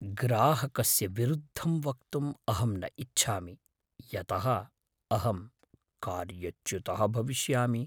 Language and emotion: Sanskrit, fearful